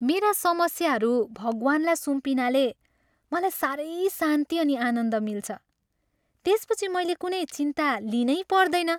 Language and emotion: Nepali, happy